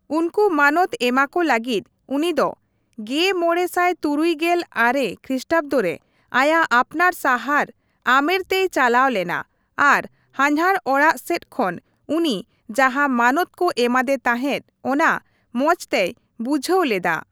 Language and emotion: Santali, neutral